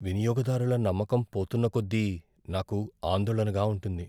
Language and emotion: Telugu, fearful